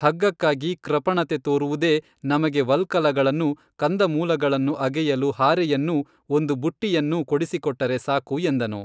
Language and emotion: Kannada, neutral